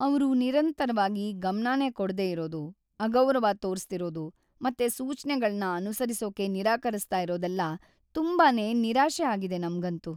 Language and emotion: Kannada, sad